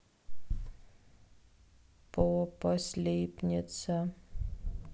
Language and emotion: Russian, sad